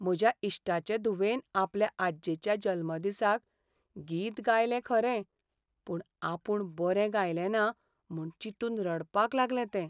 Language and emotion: Goan Konkani, sad